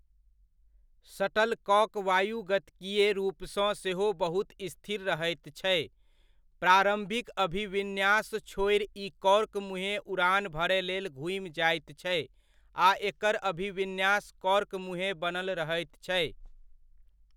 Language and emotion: Maithili, neutral